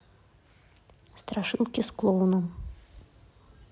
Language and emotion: Russian, neutral